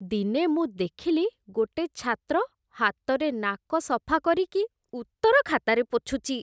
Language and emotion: Odia, disgusted